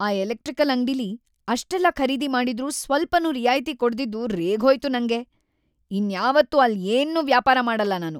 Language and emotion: Kannada, angry